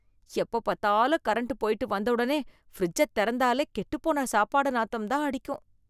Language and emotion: Tamil, disgusted